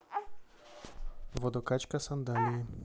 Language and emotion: Russian, neutral